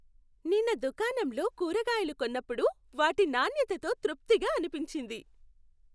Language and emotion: Telugu, happy